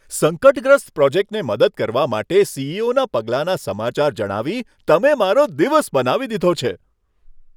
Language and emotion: Gujarati, happy